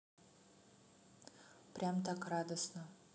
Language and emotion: Russian, neutral